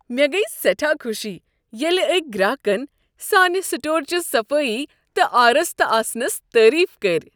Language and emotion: Kashmiri, happy